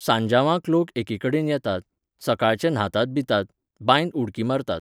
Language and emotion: Goan Konkani, neutral